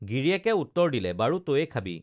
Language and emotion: Assamese, neutral